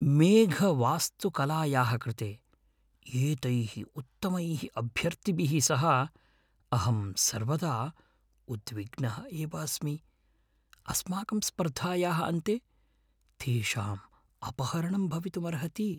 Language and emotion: Sanskrit, fearful